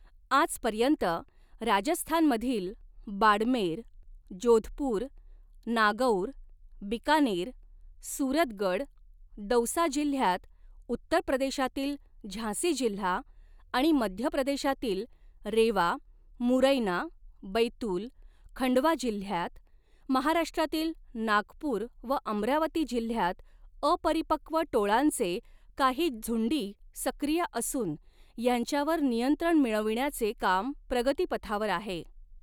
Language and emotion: Marathi, neutral